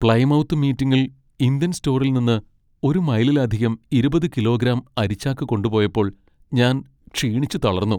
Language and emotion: Malayalam, sad